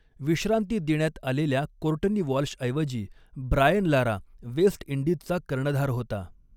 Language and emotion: Marathi, neutral